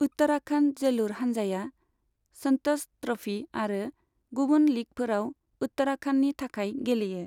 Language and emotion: Bodo, neutral